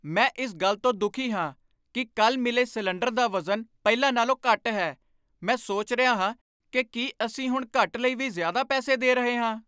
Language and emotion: Punjabi, angry